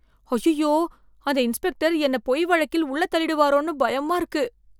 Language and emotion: Tamil, fearful